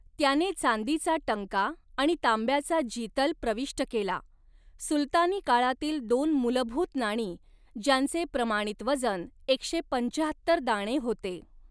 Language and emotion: Marathi, neutral